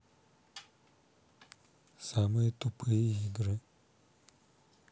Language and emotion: Russian, neutral